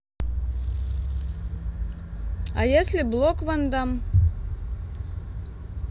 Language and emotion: Russian, neutral